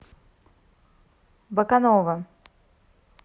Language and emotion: Russian, neutral